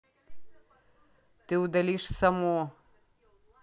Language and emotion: Russian, neutral